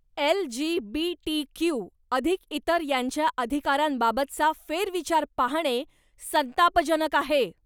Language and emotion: Marathi, angry